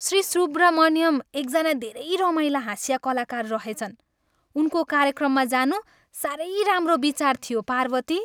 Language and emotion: Nepali, happy